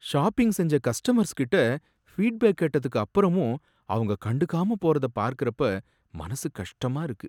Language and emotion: Tamil, sad